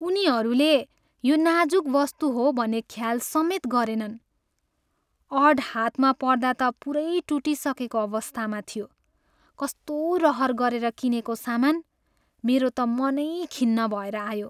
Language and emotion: Nepali, sad